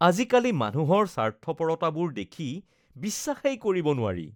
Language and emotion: Assamese, disgusted